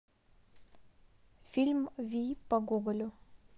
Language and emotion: Russian, neutral